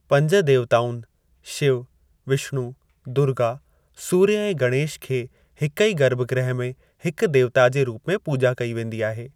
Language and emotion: Sindhi, neutral